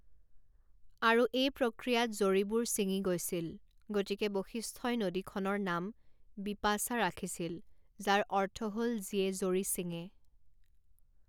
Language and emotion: Assamese, neutral